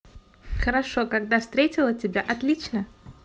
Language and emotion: Russian, positive